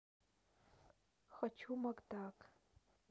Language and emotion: Russian, neutral